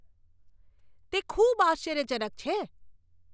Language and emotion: Gujarati, surprised